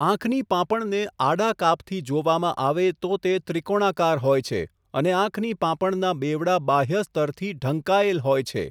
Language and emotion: Gujarati, neutral